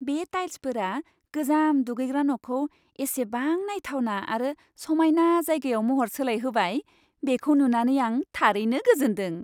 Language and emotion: Bodo, happy